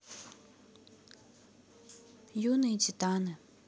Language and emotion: Russian, neutral